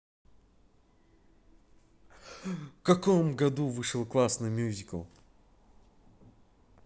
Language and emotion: Russian, positive